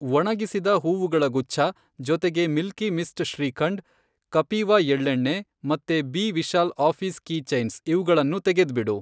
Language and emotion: Kannada, neutral